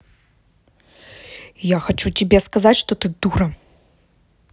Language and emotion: Russian, angry